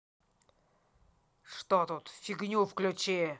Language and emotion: Russian, angry